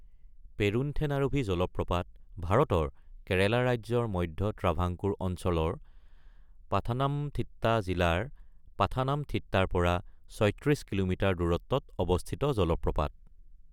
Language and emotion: Assamese, neutral